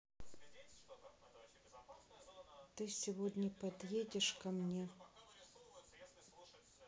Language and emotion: Russian, sad